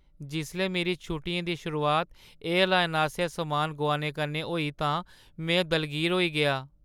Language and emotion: Dogri, sad